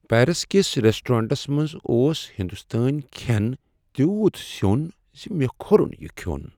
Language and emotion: Kashmiri, sad